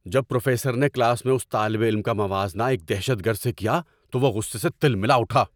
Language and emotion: Urdu, angry